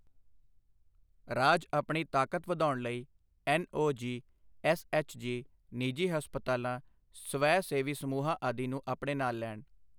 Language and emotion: Punjabi, neutral